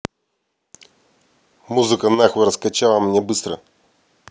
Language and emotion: Russian, angry